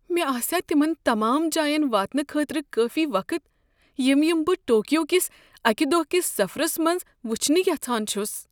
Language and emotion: Kashmiri, fearful